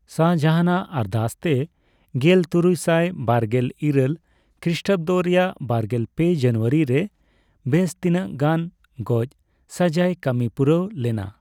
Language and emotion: Santali, neutral